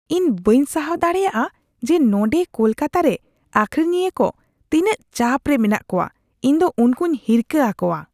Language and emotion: Santali, disgusted